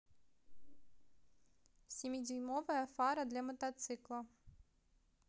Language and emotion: Russian, neutral